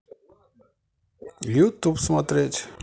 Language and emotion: Russian, positive